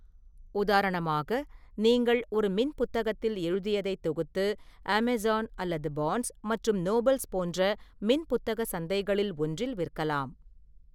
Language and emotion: Tamil, neutral